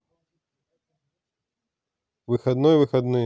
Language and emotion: Russian, neutral